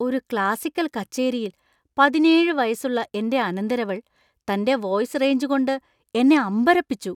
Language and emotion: Malayalam, surprised